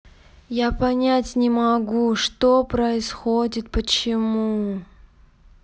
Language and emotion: Russian, sad